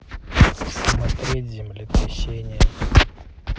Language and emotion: Russian, neutral